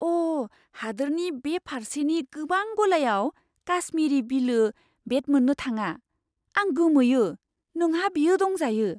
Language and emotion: Bodo, surprised